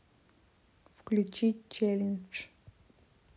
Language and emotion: Russian, neutral